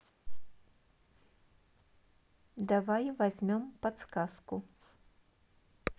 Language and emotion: Russian, neutral